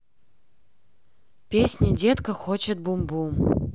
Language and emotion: Russian, neutral